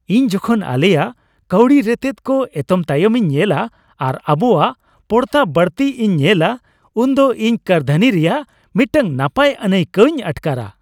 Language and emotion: Santali, happy